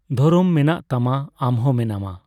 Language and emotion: Santali, neutral